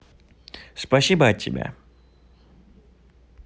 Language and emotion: Russian, positive